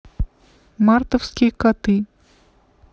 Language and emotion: Russian, neutral